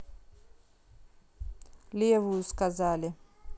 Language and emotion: Russian, neutral